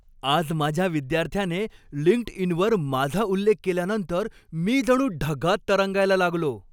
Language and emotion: Marathi, happy